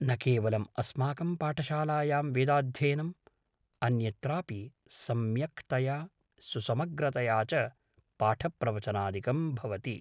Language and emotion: Sanskrit, neutral